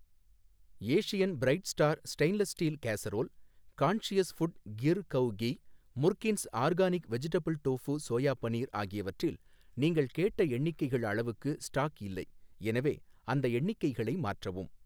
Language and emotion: Tamil, neutral